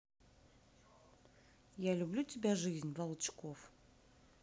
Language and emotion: Russian, neutral